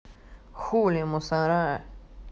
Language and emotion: Russian, neutral